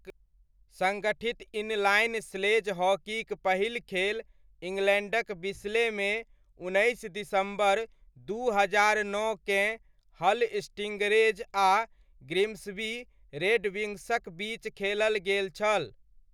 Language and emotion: Maithili, neutral